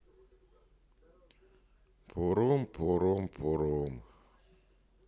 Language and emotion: Russian, sad